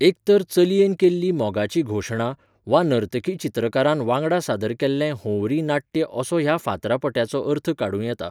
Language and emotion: Goan Konkani, neutral